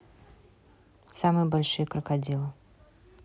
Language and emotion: Russian, neutral